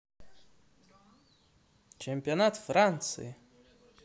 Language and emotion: Russian, positive